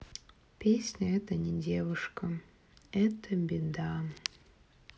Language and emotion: Russian, sad